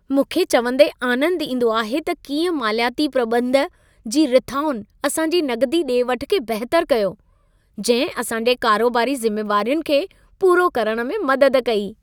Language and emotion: Sindhi, happy